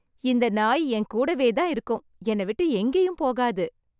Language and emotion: Tamil, happy